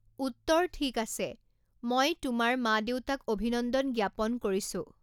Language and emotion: Assamese, neutral